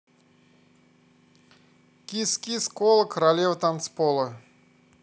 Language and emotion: Russian, positive